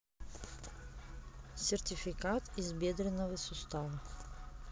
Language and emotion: Russian, neutral